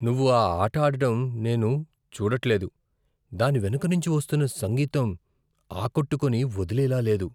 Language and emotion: Telugu, fearful